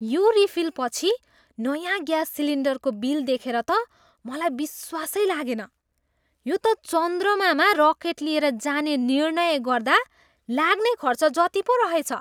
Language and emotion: Nepali, surprised